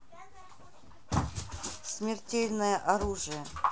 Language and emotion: Russian, neutral